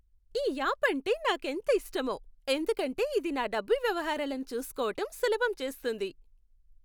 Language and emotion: Telugu, happy